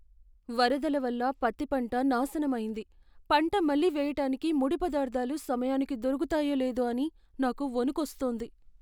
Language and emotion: Telugu, fearful